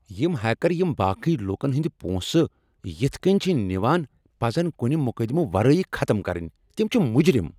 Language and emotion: Kashmiri, angry